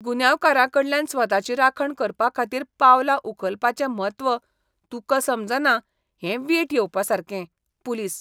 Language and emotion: Goan Konkani, disgusted